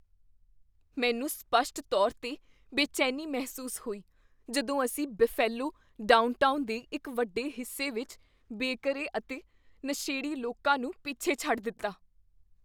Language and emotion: Punjabi, fearful